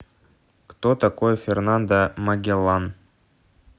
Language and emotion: Russian, neutral